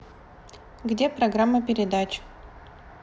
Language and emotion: Russian, neutral